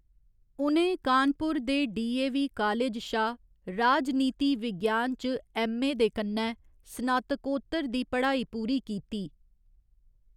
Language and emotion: Dogri, neutral